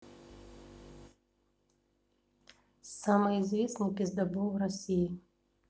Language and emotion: Russian, neutral